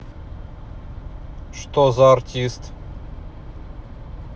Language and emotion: Russian, neutral